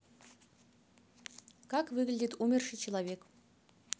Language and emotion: Russian, neutral